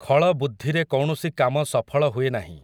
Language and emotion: Odia, neutral